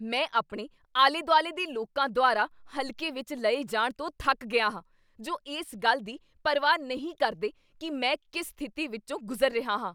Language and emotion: Punjabi, angry